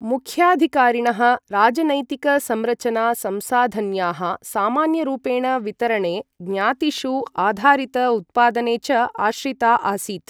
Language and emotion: Sanskrit, neutral